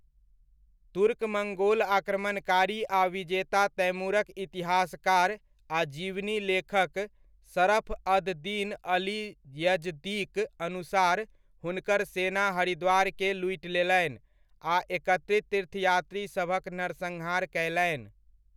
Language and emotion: Maithili, neutral